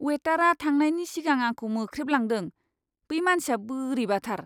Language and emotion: Bodo, disgusted